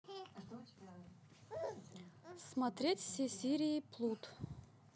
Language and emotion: Russian, neutral